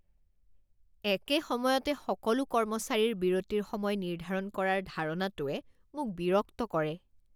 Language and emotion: Assamese, disgusted